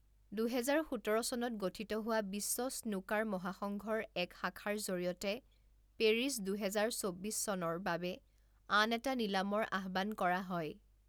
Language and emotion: Assamese, neutral